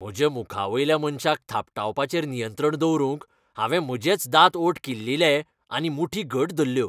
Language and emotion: Goan Konkani, angry